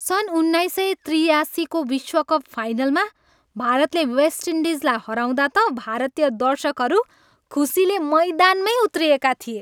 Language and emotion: Nepali, happy